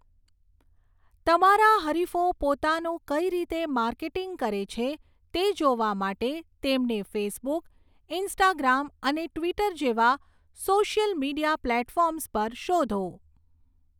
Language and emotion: Gujarati, neutral